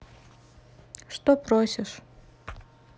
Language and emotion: Russian, neutral